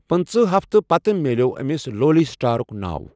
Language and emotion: Kashmiri, neutral